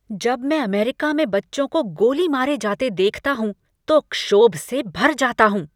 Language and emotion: Hindi, angry